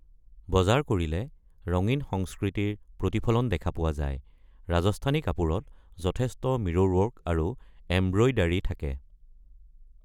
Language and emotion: Assamese, neutral